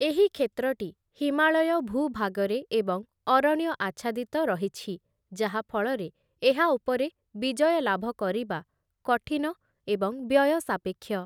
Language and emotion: Odia, neutral